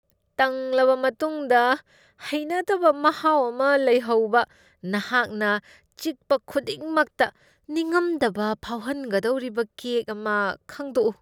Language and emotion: Manipuri, disgusted